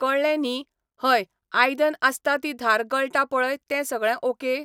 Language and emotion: Goan Konkani, neutral